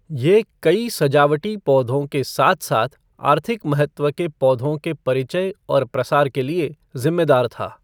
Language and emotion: Hindi, neutral